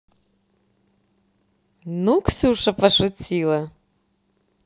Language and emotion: Russian, positive